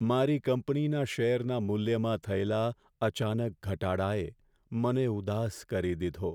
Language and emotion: Gujarati, sad